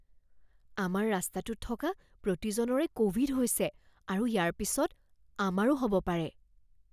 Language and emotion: Assamese, fearful